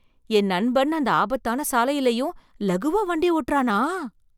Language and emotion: Tamil, surprised